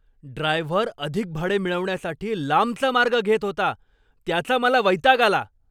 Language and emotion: Marathi, angry